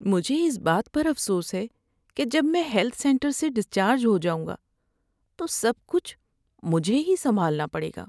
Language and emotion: Urdu, sad